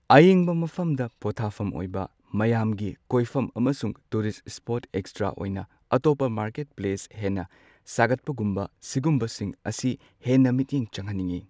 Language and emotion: Manipuri, neutral